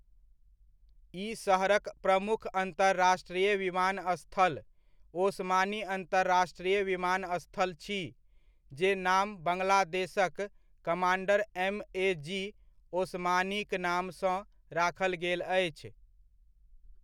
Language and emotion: Maithili, neutral